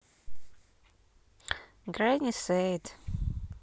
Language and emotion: Russian, neutral